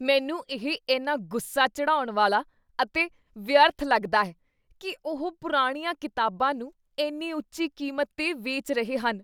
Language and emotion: Punjabi, disgusted